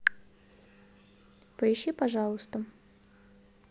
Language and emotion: Russian, neutral